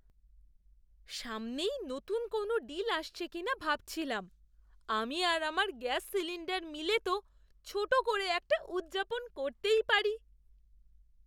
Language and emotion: Bengali, surprised